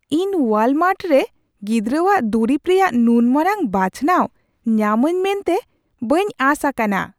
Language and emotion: Santali, surprised